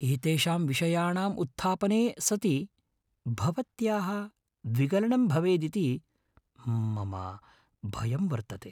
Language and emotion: Sanskrit, fearful